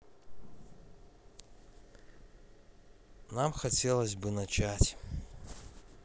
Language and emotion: Russian, neutral